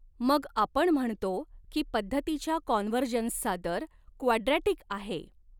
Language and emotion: Marathi, neutral